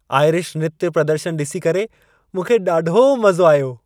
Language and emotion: Sindhi, happy